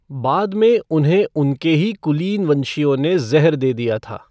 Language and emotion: Hindi, neutral